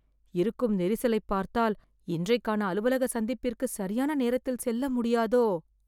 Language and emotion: Tamil, fearful